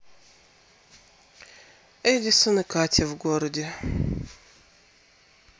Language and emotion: Russian, sad